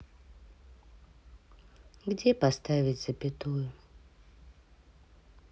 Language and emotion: Russian, sad